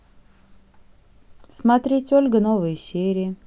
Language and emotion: Russian, neutral